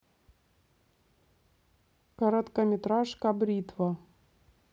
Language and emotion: Russian, neutral